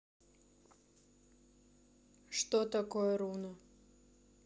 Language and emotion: Russian, neutral